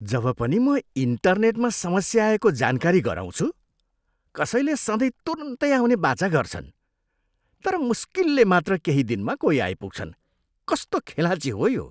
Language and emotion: Nepali, disgusted